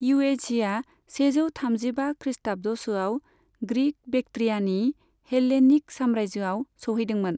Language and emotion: Bodo, neutral